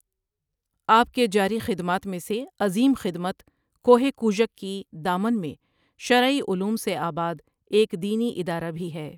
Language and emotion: Urdu, neutral